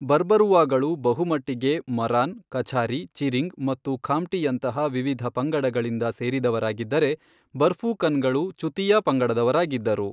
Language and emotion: Kannada, neutral